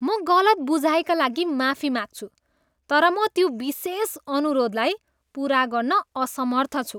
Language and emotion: Nepali, disgusted